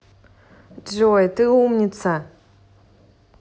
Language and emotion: Russian, positive